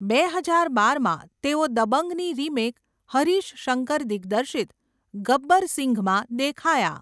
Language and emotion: Gujarati, neutral